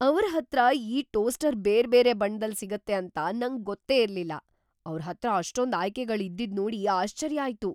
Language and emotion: Kannada, surprised